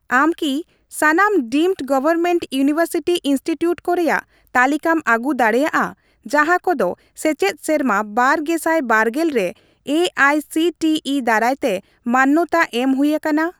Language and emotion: Santali, neutral